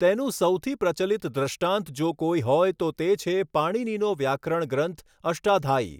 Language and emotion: Gujarati, neutral